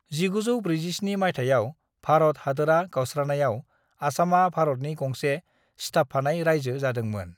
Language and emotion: Bodo, neutral